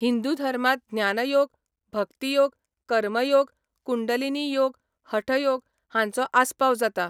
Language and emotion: Goan Konkani, neutral